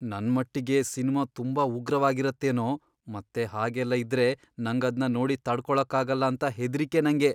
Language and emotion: Kannada, fearful